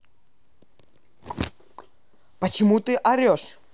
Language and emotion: Russian, angry